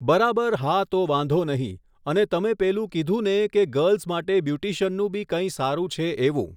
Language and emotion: Gujarati, neutral